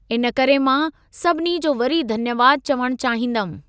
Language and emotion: Sindhi, neutral